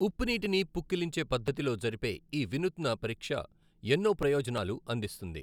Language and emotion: Telugu, neutral